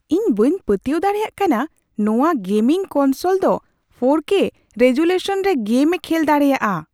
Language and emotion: Santali, surprised